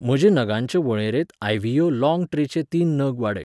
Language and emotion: Goan Konkani, neutral